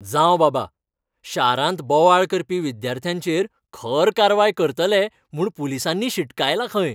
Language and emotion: Goan Konkani, happy